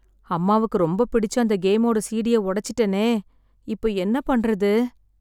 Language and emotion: Tamil, sad